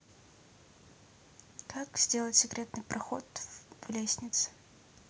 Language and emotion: Russian, neutral